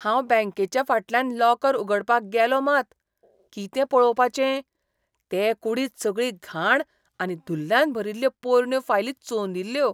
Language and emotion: Goan Konkani, disgusted